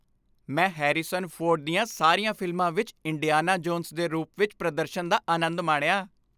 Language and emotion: Punjabi, happy